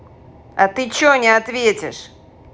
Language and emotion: Russian, angry